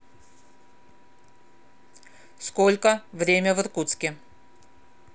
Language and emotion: Russian, neutral